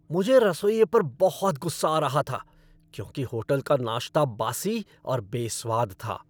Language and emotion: Hindi, angry